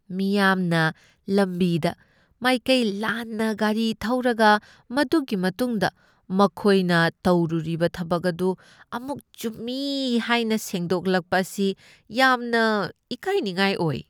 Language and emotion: Manipuri, disgusted